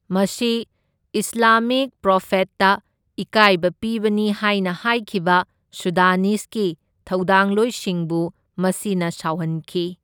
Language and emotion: Manipuri, neutral